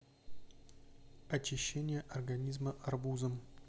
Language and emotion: Russian, neutral